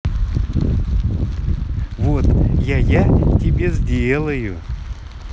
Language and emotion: Russian, positive